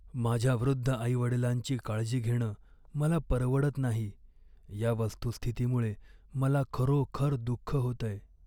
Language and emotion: Marathi, sad